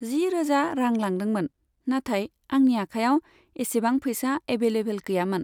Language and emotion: Bodo, neutral